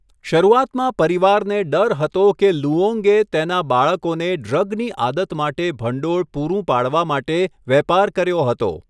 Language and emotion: Gujarati, neutral